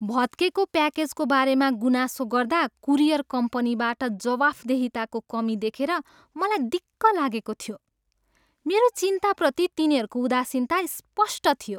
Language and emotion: Nepali, disgusted